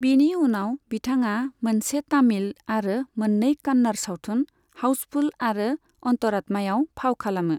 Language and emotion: Bodo, neutral